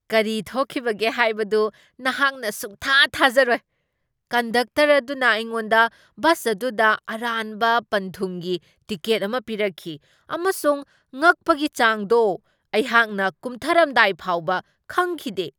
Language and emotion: Manipuri, surprised